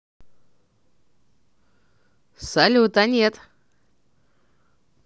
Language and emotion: Russian, positive